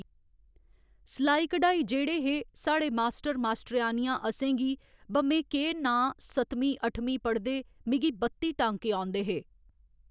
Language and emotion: Dogri, neutral